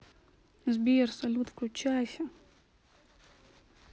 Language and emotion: Russian, sad